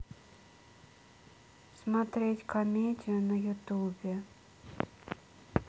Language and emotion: Russian, sad